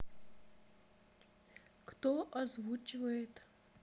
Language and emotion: Russian, neutral